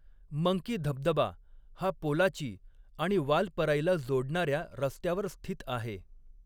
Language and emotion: Marathi, neutral